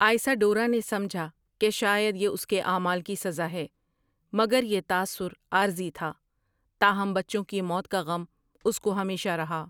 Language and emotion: Urdu, neutral